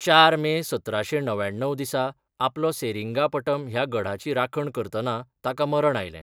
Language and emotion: Goan Konkani, neutral